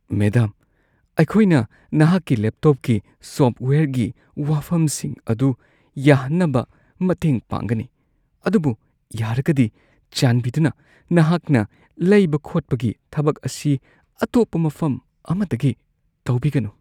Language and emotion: Manipuri, fearful